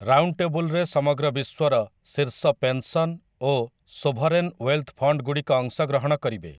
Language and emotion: Odia, neutral